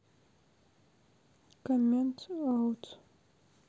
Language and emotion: Russian, sad